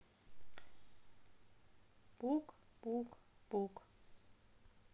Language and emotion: Russian, sad